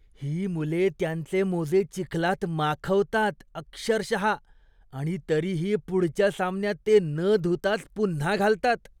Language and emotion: Marathi, disgusted